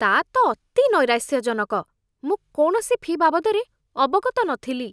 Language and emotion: Odia, disgusted